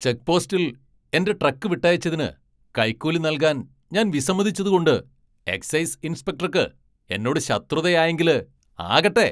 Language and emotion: Malayalam, angry